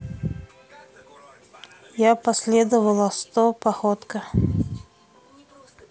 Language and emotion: Russian, neutral